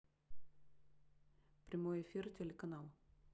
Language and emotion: Russian, neutral